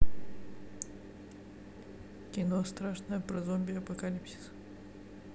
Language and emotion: Russian, neutral